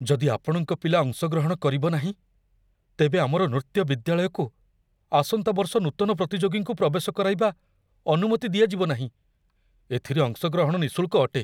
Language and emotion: Odia, fearful